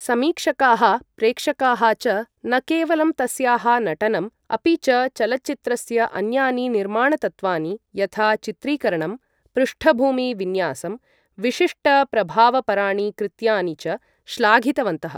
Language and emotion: Sanskrit, neutral